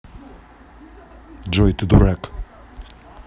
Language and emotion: Russian, neutral